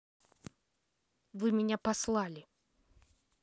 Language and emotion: Russian, angry